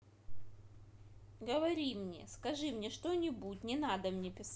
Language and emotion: Russian, angry